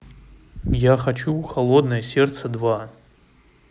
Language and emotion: Russian, neutral